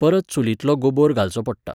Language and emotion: Goan Konkani, neutral